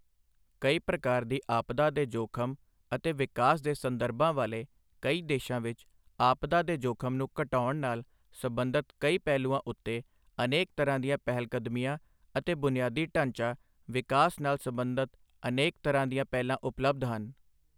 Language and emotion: Punjabi, neutral